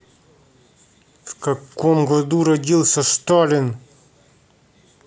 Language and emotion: Russian, angry